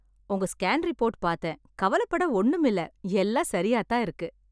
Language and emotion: Tamil, happy